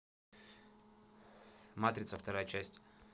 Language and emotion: Russian, neutral